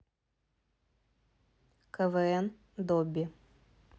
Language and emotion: Russian, neutral